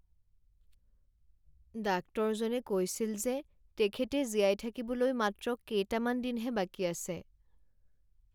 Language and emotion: Assamese, sad